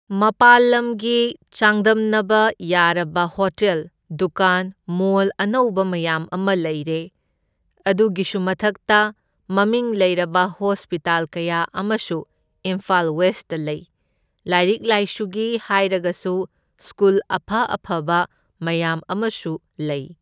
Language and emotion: Manipuri, neutral